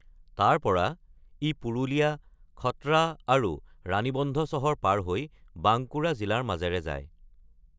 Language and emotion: Assamese, neutral